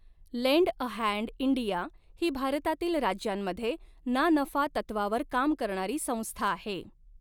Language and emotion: Marathi, neutral